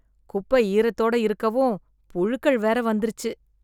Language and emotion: Tamil, disgusted